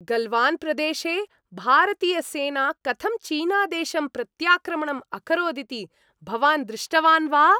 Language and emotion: Sanskrit, happy